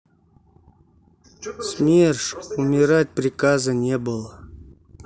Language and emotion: Russian, sad